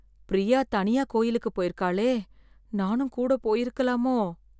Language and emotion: Tamil, fearful